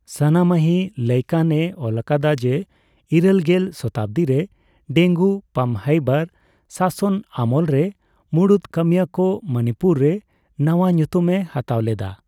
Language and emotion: Santali, neutral